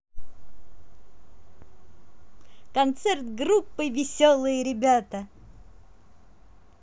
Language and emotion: Russian, positive